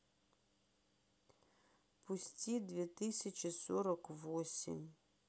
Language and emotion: Russian, sad